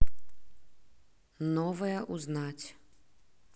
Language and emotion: Russian, neutral